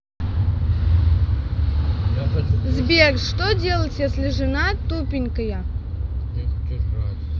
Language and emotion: Russian, neutral